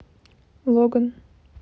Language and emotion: Russian, neutral